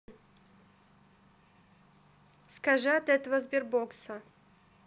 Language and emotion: Russian, neutral